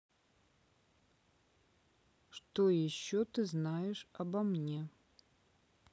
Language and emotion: Russian, neutral